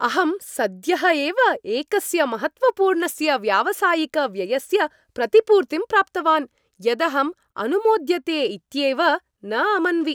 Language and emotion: Sanskrit, happy